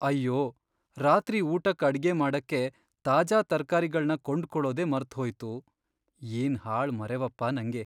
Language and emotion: Kannada, sad